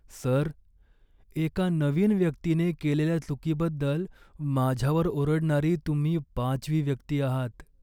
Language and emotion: Marathi, sad